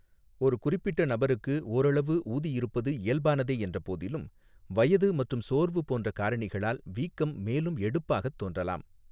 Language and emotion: Tamil, neutral